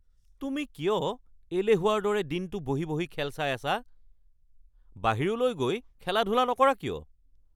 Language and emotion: Assamese, angry